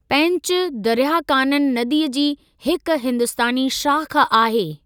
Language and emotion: Sindhi, neutral